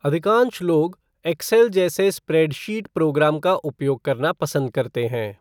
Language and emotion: Hindi, neutral